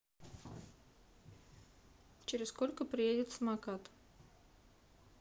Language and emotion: Russian, neutral